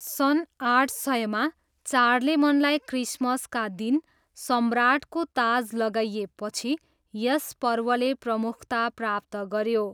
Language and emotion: Nepali, neutral